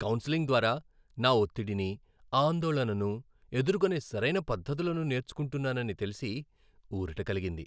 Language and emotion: Telugu, happy